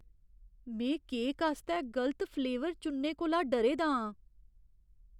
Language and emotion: Dogri, fearful